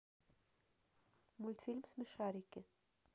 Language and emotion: Russian, neutral